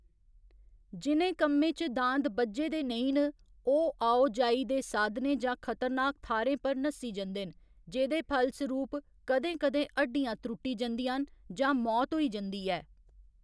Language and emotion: Dogri, neutral